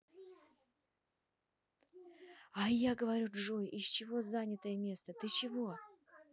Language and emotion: Russian, neutral